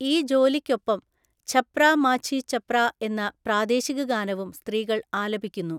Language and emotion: Malayalam, neutral